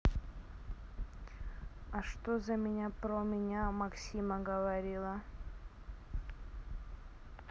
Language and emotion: Russian, neutral